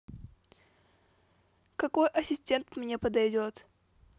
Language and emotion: Russian, neutral